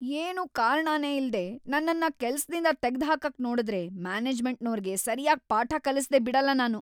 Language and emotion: Kannada, angry